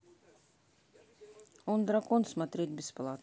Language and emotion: Russian, neutral